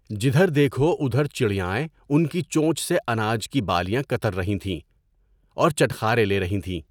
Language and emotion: Urdu, neutral